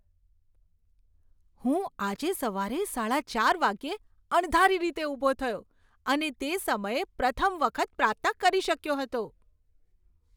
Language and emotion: Gujarati, surprised